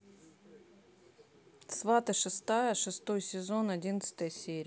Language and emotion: Russian, neutral